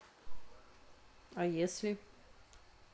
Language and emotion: Russian, neutral